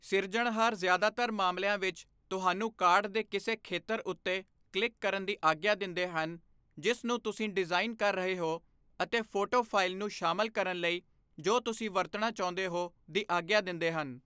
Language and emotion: Punjabi, neutral